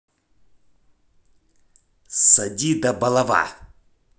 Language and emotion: Russian, angry